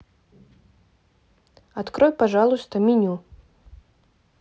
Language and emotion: Russian, neutral